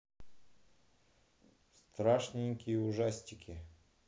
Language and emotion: Russian, neutral